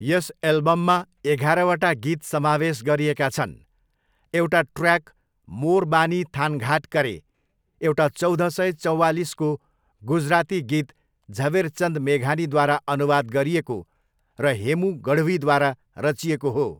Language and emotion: Nepali, neutral